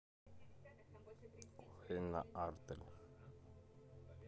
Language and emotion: Russian, neutral